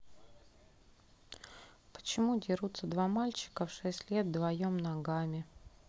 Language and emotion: Russian, neutral